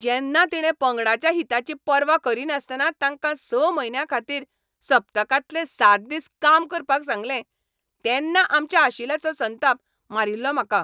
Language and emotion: Goan Konkani, angry